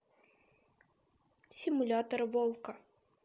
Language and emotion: Russian, neutral